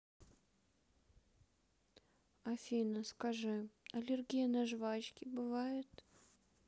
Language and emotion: Russian, sad